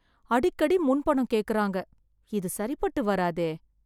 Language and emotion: Tamil, sad